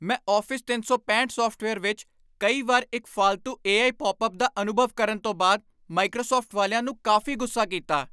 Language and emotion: Punjabi, angry